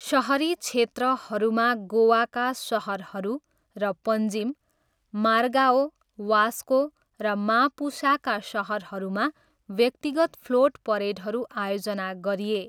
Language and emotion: Nepali, neutral